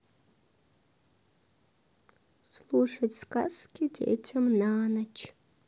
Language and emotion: Russian, sad